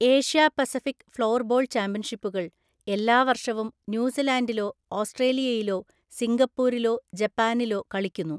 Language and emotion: Malayalam, neutral